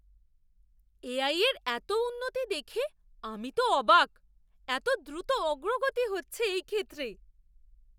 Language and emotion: Bengali, surprised